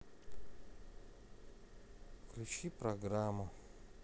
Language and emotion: Russian, sad